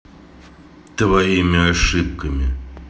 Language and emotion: Russian, neutral